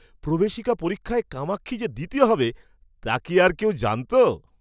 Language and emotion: Bengali, surprised